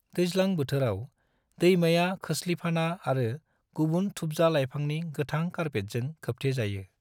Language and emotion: Bodo, neutral